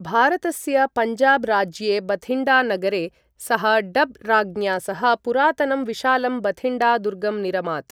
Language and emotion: Sanskrit, neutral